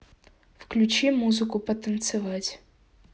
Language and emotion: Russian, neutral